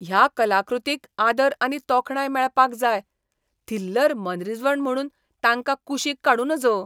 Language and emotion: Goan Konkani, disgusted